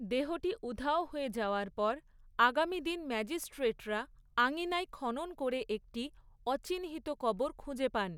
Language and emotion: Bengali, neutral